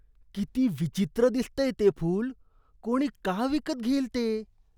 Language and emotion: Marathi, disgusted